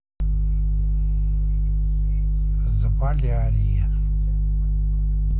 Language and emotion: Russian, neutral